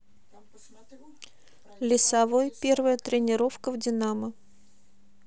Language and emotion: Russian, neutral